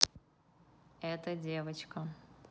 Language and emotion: Russian, neutral